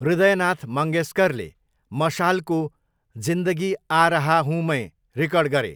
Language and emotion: Nepali, neutral